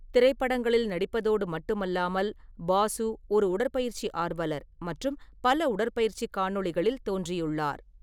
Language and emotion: Tamil, neutral